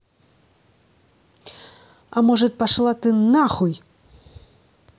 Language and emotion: Russian, angry